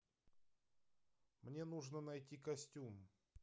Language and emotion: Russian, neutral